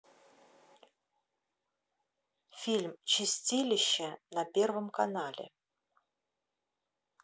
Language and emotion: Russian, neutral